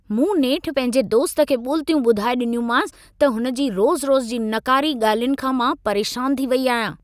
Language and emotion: Sindhi, angry